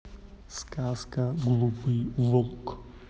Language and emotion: Russian, neutral